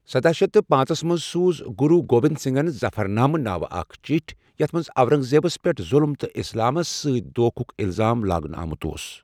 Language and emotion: Kashmiri, neutral